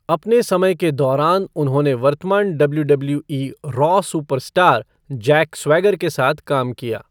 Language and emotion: Hindi, neutral